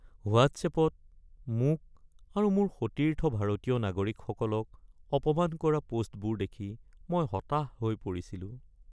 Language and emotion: Assamese, sad